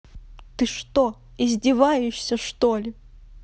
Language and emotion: Russian, angry